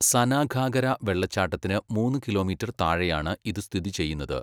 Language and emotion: Malayalam, neutral